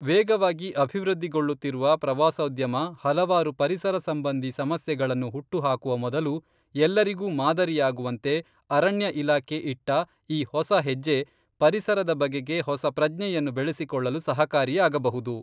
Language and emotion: Kannada, neutral